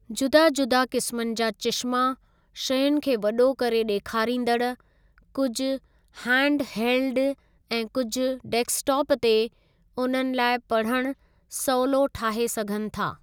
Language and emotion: Sindhi, neutral